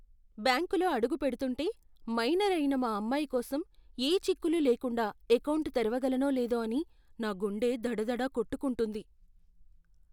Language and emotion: Telugu, fearful